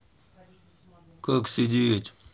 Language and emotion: Russian, neutral